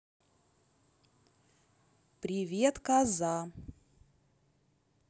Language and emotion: Russian, neutral